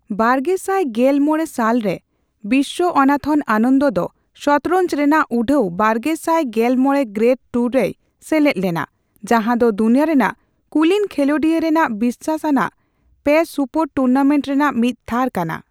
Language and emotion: Santali, neutral